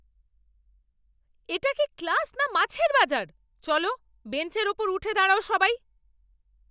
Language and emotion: Bengali, angry